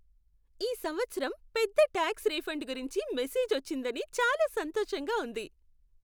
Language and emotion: Telugu, happy